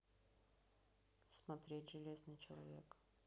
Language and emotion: Russian, neutral